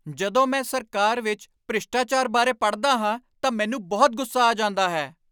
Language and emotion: Punjabi, angry